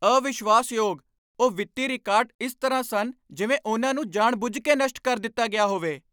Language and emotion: Punjabi, angry